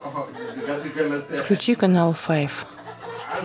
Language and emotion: Russian, neutral